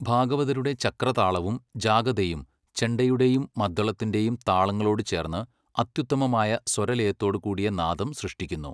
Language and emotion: Malayalam, neutral